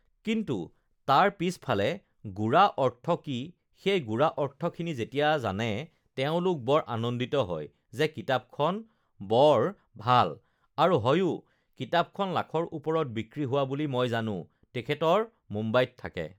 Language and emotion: Assamese, neutral